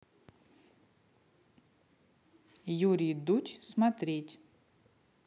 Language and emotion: Russian, neutral